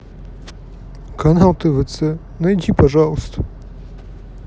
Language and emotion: Russian, sad